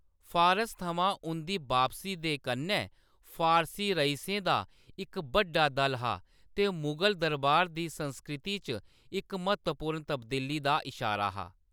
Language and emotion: Dogri, neutral